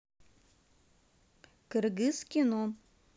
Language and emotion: Russian, neutral